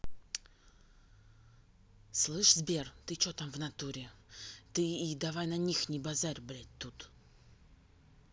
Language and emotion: Russian, angry